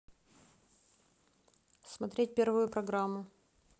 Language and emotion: Russian, neutral